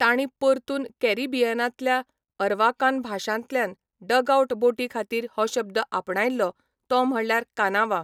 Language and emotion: Goan Konkani, neutral